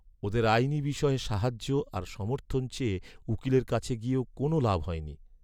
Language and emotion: Bengali, sad